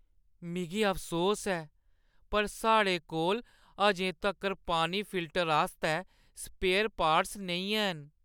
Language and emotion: Dogri, sad